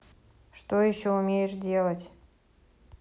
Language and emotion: Russian, neutral